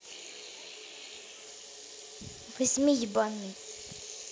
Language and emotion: Russian, neutral